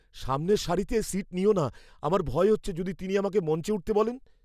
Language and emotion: Bengali, fearful